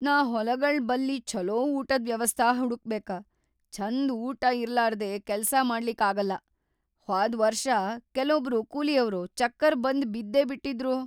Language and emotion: Kannada, fearful